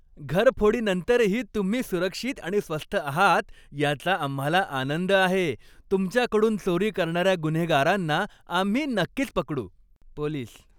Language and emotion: Marathi, happy